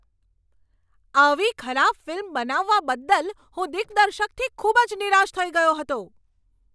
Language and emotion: Gujarati, angry